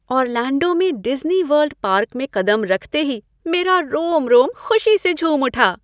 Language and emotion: Hindi, happy